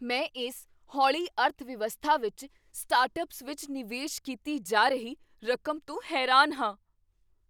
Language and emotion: Punjabi, surprised